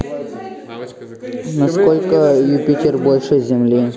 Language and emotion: Russian, neutral